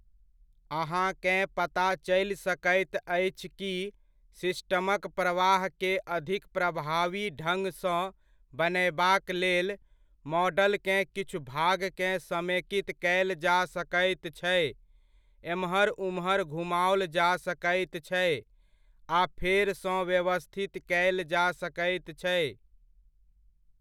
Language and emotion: Maithili, neutral